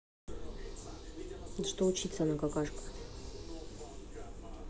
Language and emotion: Russian, neutral